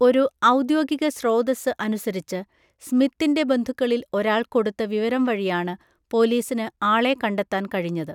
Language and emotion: Malayalam, neutral